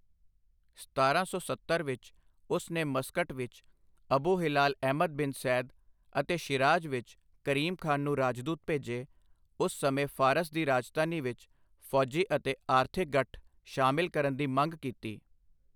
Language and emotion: Punjabi, neutral